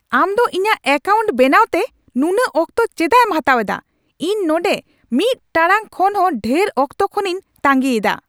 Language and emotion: Santali, angry